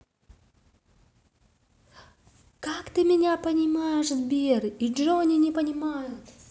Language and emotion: Russian, positive